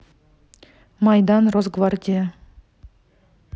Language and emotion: Russian, neutral